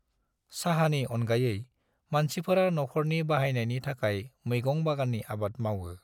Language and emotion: Bodo, neutral